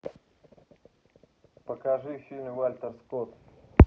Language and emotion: Russian, neutral